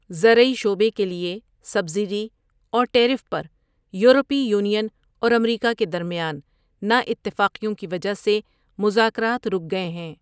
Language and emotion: Urdu, neutral